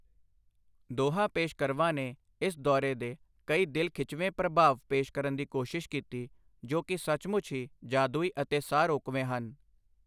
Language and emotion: Punjabi, neutral